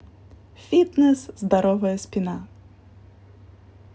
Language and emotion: Russian, positive